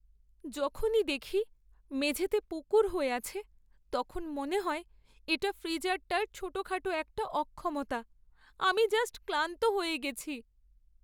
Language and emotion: Bengali, sad